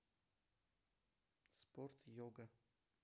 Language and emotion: Russian, neutral